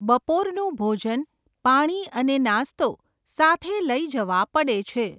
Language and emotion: Gujarati, neutral